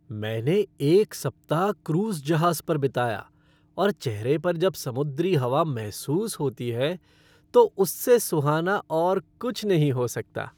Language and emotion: Hindi, happy